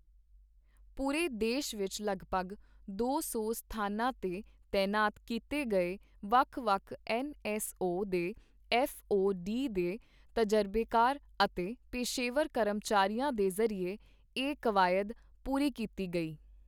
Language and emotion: Punjabi, neutral